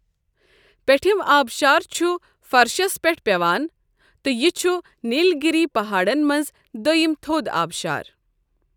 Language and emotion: Kashmiri, neutral